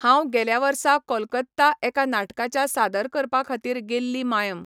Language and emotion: Goan Konkani, neutral